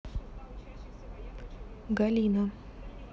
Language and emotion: Russian, neutral